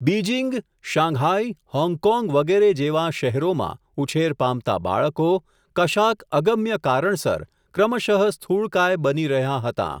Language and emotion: Gujarati, neutral